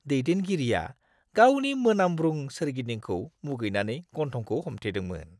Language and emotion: Bodo, disgusted